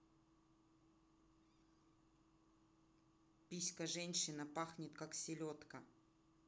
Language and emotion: Russian, neutral